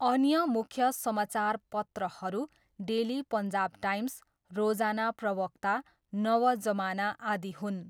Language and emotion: Nepali, neutral